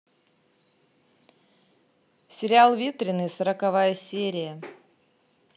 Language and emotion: Russian, positive